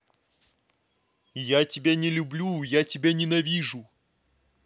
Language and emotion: Russian, angry